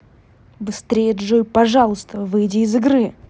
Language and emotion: Russian, angry